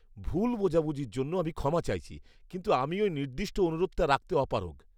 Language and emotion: Bengali, disgusted